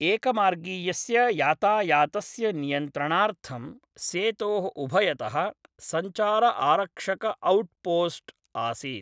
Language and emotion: Sanskrit, neutral